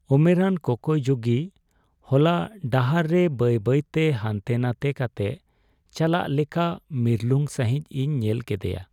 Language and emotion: Santali, sad